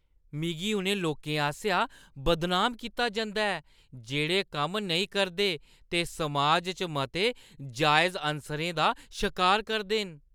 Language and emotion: Dogri, disgusted